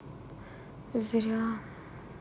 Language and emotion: Russian, sad